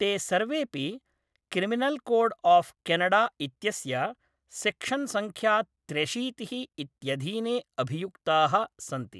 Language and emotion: Sanskrit, neutral